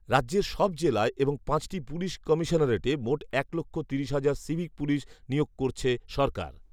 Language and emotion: Bengali, neutral